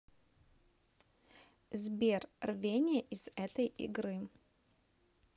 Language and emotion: Russian, neutral